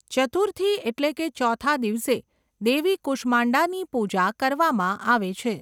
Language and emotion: Gujarati, neutral